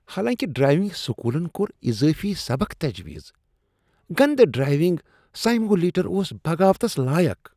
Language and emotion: Kashmiri, disgusted